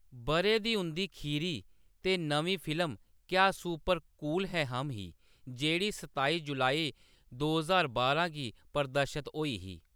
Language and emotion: Dogri, neutral